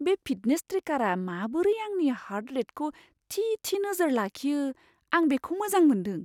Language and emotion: Bodo, surprised